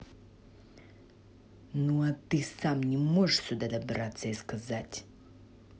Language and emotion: Russian, angry